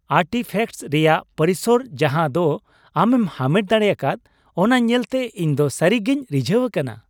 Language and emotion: Santali, happy